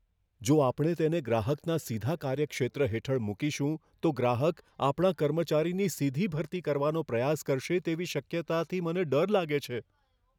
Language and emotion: Gujarati, fearful